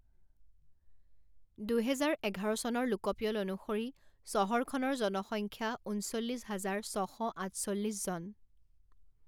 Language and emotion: Assamese, neutral